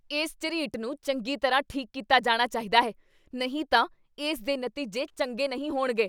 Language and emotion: Punjabi, angry